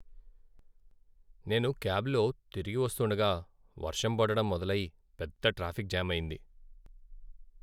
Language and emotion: Telugu, sad